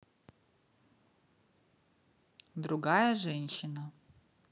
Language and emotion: Russian, neutral